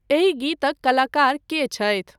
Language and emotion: Maithili, neutral